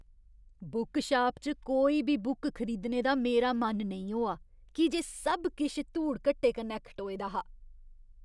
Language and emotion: Dogri, disgusted